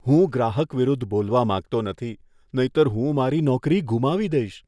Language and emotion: Gujarati, fearful